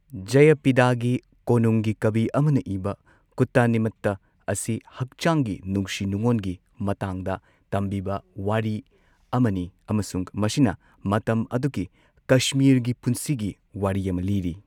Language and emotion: Manipuri, neutral